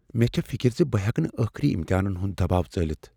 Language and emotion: Kashmiri, fearful